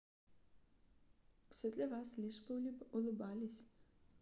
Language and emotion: Russian, neutral